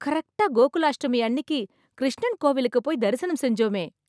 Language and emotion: Tamil, happy